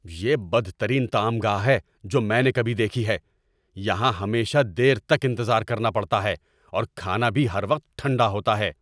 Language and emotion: Urdu, angry